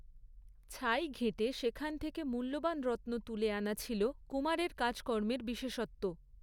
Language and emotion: Bengali, neutral